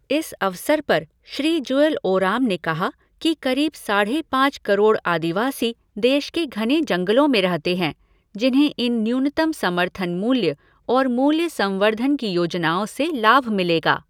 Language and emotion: Hindi, neutral